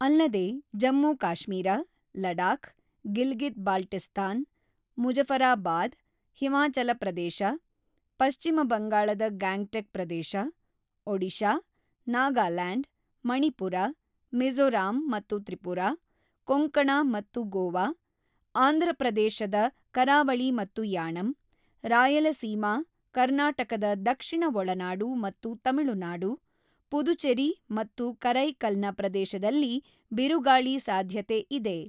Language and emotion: Kannada, neutral